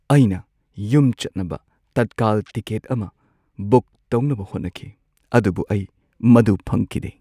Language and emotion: Manipuri, sad